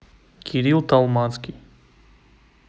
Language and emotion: Russian, neutral